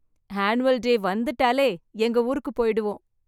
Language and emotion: Tamil, happy